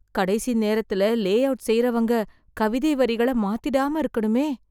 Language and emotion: Tamil, fearful